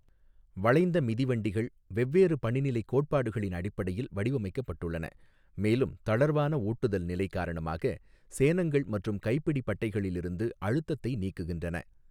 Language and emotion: Tamil, neutral